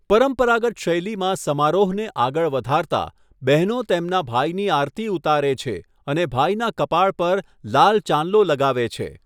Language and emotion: Gujarati, neutral